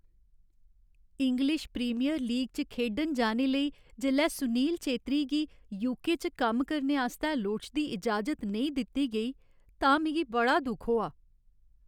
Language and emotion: Dogri, sad